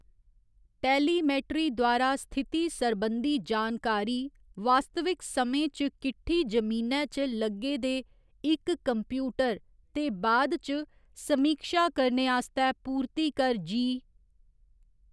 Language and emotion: Dogri, neutral